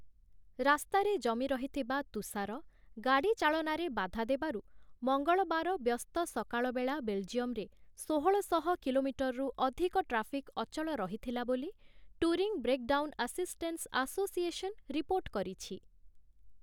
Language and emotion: Odia, neutral